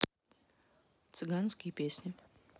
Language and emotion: Russian, neutral